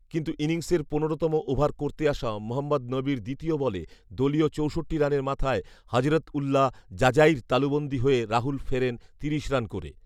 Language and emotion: Bengali, neutral